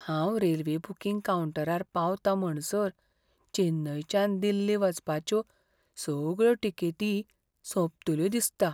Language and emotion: Goan Konkani, fearful